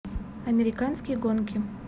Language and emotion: Russian, neutral